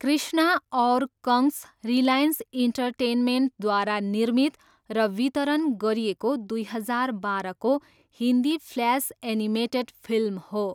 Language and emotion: Nepali, neutral